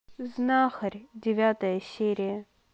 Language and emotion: Russian, neutral